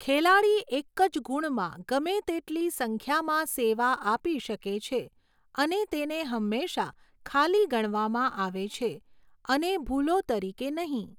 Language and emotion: Gujarati, neutral